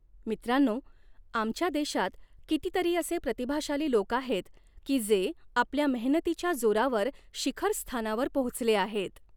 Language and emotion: Marathi, neutral